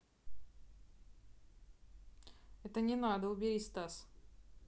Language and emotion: Russian, neutral